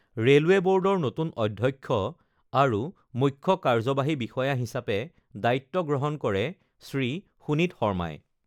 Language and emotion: Assamese, neutral